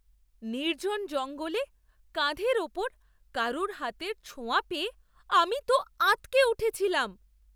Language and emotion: Bengali, surprised